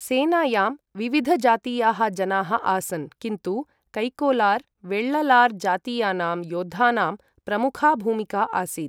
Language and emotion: Sanskrit, neutral